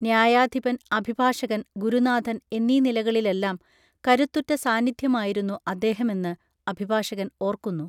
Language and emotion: Malayalam, neutral